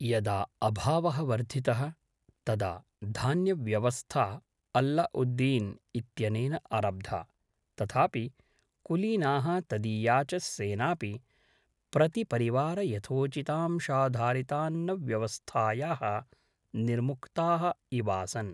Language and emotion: Sanskrit, neutral